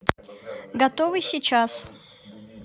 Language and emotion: Russian, neutral